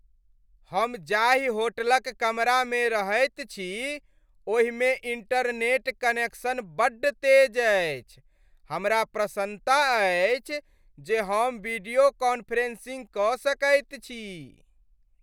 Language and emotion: Maithili, happy